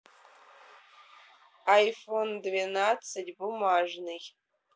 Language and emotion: Russian, neutral